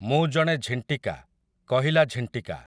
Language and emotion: Odia, neutral